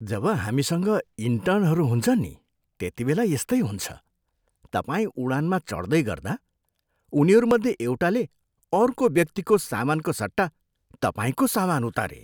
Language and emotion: Nepali, disgusted